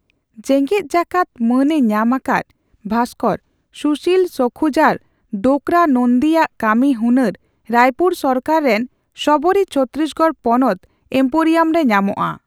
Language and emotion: Santali, neutral